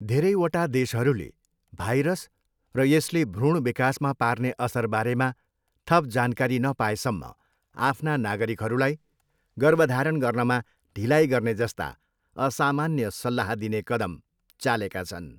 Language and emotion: Nepali, neutral